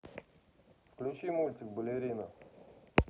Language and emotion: Russian, neutral